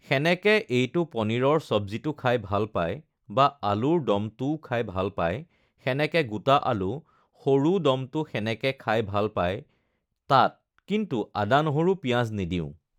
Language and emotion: Assamese, neutral